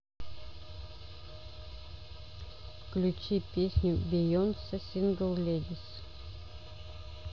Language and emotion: Russian, neutral